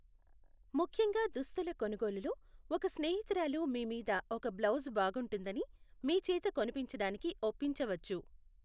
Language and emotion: Telugu, neutral